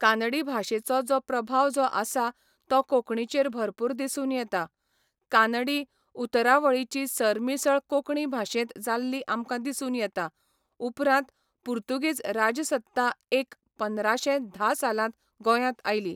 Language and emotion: Goan Konkani, neutral